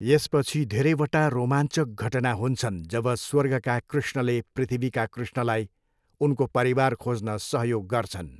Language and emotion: Nepali, neutral